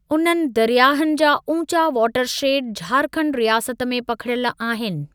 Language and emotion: Sindhi, neutral